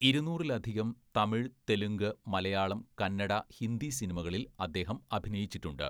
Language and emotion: Malayalam, neutral